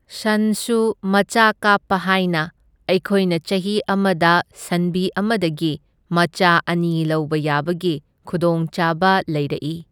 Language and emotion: Manipuri, neutral